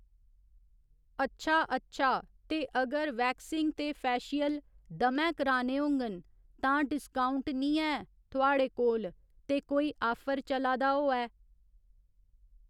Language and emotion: Dogri, neutral